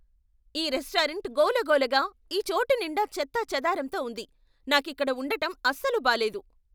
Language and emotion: Telugu, angry